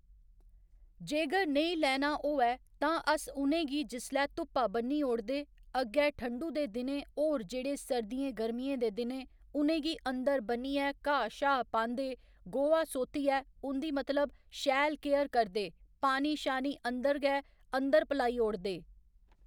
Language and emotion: Dogri, neutral